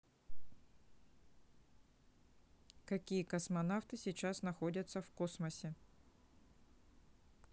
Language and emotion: Russian, neutral